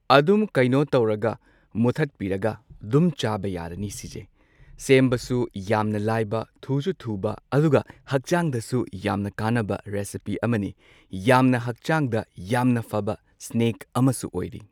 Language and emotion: Manipuri, neutral